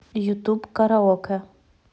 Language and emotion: Russian, neutral